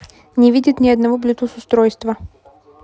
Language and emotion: Russian, neutral